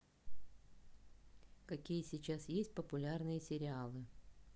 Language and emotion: Russian, neutral